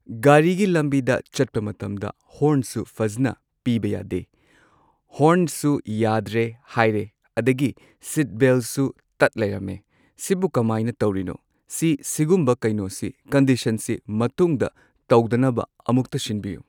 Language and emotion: Manipuri, neutral